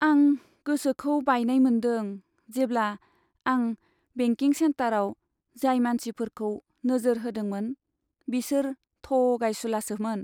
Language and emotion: Bodo, sad